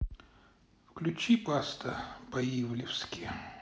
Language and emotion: Russian, neutral